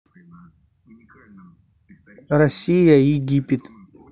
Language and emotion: Russian, neutral